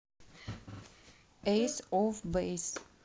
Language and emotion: Russian, neutral